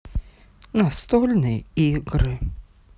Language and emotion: Russian, sad